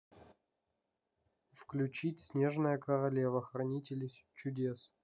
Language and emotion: Russian, neutral